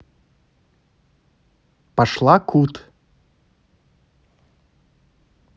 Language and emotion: Russian, neutral